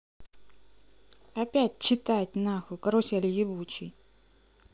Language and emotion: Russian, angry